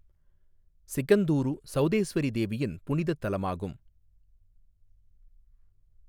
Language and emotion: Tamil, neutral